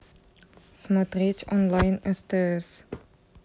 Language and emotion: Russian, neutral